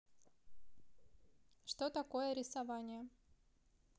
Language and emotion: Russian, neutral